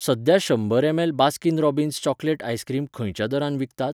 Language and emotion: Goan Konkani, neutral